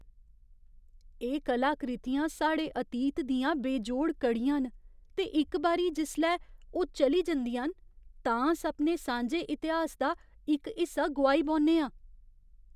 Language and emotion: Dogri, fearful